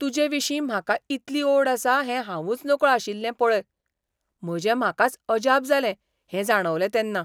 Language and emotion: Goan Konkani, surprised